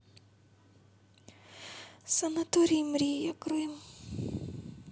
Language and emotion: Russian, sad